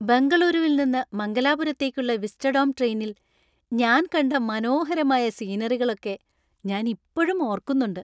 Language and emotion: Malayalam, happy